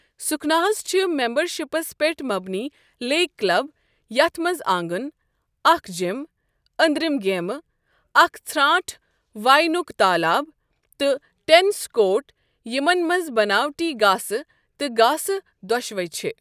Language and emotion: Kashmiri, neutral